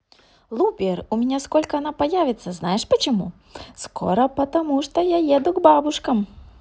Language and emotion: Russian, positive